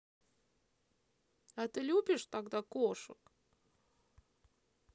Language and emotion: Russian, neutral